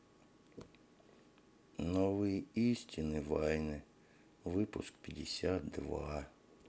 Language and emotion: Russian, sad